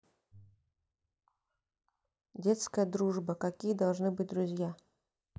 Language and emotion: Russian, neutral